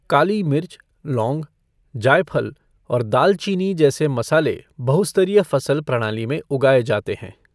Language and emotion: Hindi, neutral